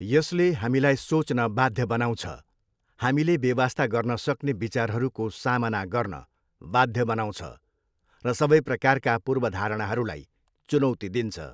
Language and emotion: Nepali, neutral